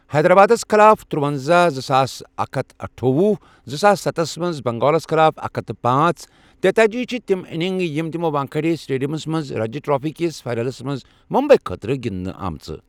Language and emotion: Kashmiri, neutral